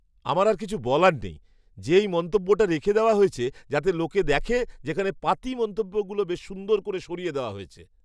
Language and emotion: Bengali, surprised